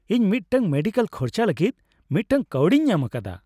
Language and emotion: Santali, happy